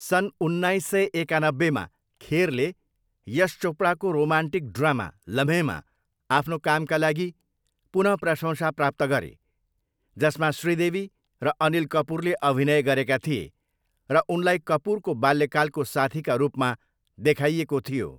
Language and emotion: Nepali, neutral